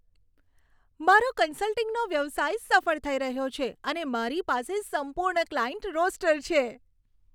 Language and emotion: Gujarati, happy